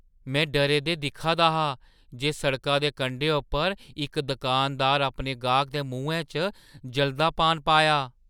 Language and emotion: Dogri, surprised